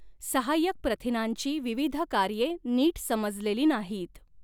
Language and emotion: Marathi, neutral